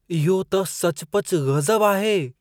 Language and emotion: Sindhi, surprised